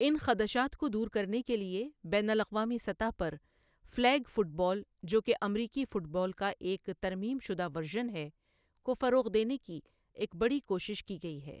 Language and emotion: Urdu, neutral